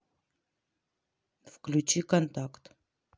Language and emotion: Russian, neutral